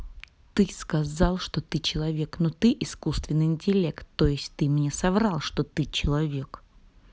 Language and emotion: Russian, angry